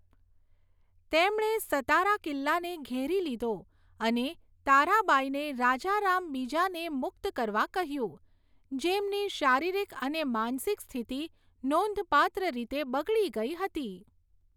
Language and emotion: Gujarati, neutral